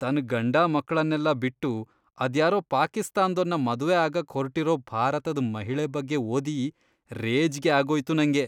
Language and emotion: Kannada, disgusted